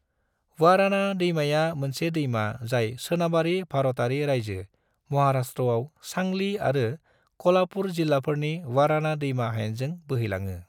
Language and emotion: Bodo, neutral